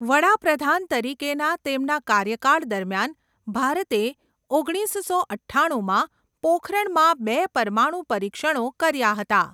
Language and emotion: Gujarati, neutral